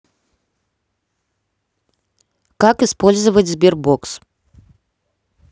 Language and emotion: Russian, neutral